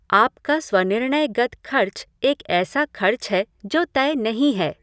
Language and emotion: Hindi, neutral